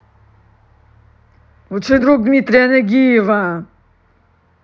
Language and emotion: Russian, angry